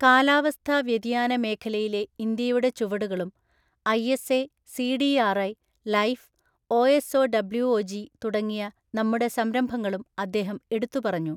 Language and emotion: Malayalam, neutral